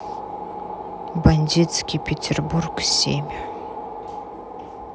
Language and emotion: Russian, neutral